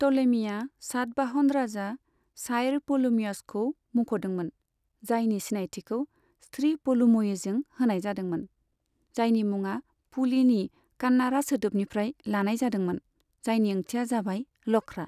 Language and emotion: Bodo, neutral